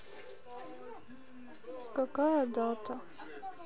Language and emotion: Russian, sad